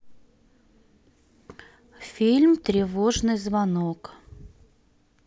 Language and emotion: Russian, neutral